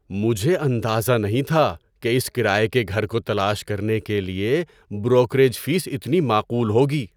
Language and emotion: Urdu, surprised